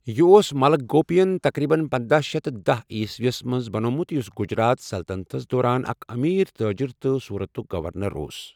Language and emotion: Kashmiri, neutral